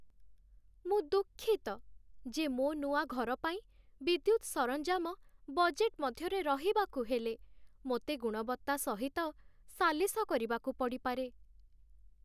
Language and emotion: Odia, sad